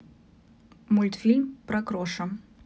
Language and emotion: Russian, neutral